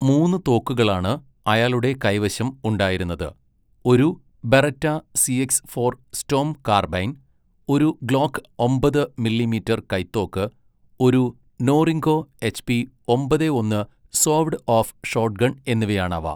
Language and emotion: Malayalam, neutral